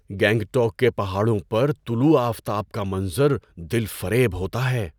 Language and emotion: Urdu, surprised